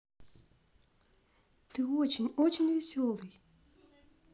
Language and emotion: Russian, positive